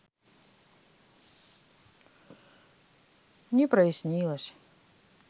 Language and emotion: Russian, sad